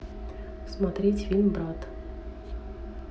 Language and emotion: Russian, neutral